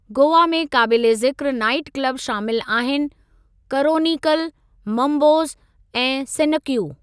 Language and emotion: Sindhi, neutral